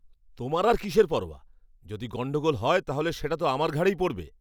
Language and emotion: Bengali, angry